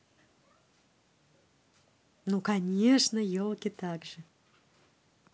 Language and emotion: Russian, positive